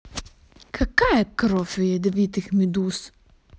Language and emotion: Russian, angry